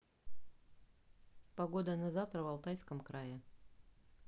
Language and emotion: Russian, neutral